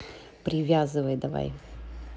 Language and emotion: Russian, neutral